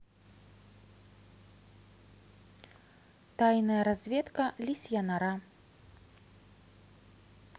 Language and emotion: Russian, neutral